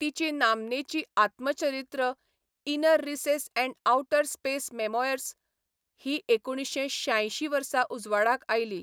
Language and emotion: Goan Konkani, neutral